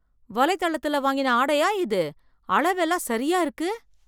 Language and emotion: Tamil, surprised